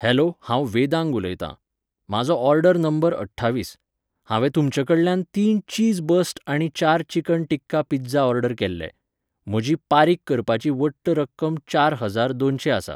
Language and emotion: Goan Konkani, neutral